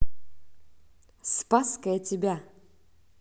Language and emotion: Russian, positive